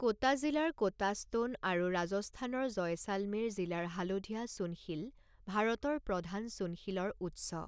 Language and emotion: Assamese, neutral